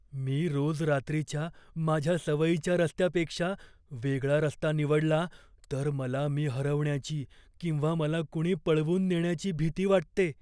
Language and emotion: Marathi, fearful